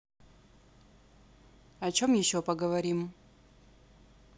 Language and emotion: Russian, neutral